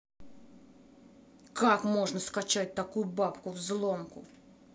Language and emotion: Russian, angry